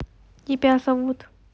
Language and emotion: Russian, neutral